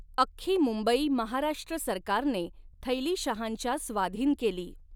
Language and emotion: Marathi, neutral